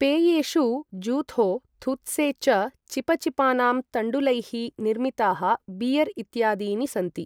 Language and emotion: Sanskrit, neutral